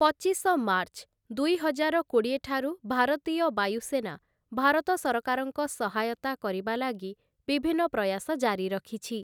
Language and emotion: Odia, neutral